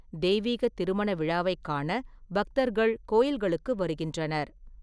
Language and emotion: Tamil, neutral